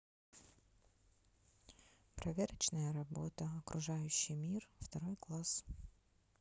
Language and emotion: Russian, neutral